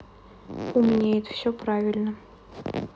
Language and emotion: Russian, neutral